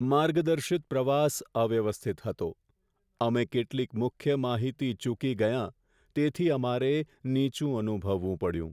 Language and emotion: Gujarati, sad